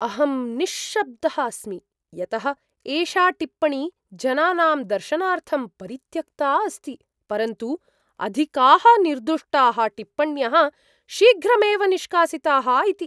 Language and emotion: Sanskrit, surprised